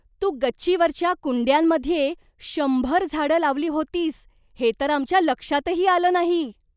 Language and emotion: Marathi, surprised